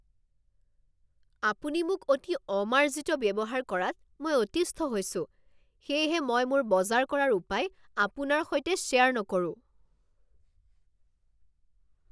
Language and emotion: Assamese, angry